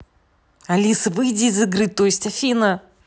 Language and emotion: Russian, angry